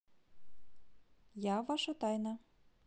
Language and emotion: Russian, neutral